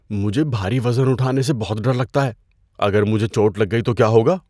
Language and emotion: Urdu, fearful